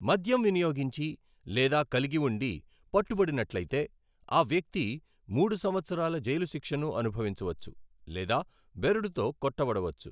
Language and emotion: Telugu, neutral